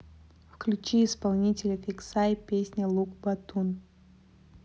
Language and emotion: Russian, neutral